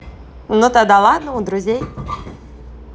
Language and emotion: Russian, positive